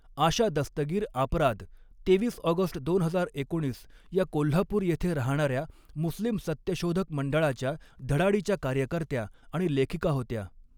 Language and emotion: Marathi, neutral